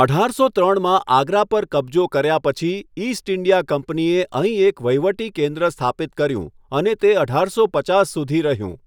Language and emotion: Gujarati, neutral